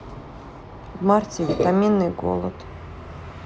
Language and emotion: Russian, sad